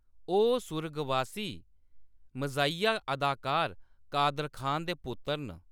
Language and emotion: Dogri, neutral